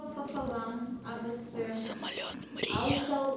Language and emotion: Russian, neutral